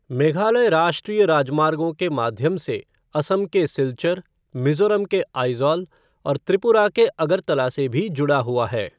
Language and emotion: Hindi, neutral